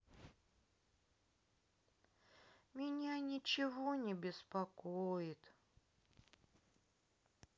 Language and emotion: Russian, sad